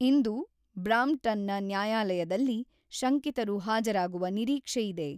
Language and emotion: Kannada, neutral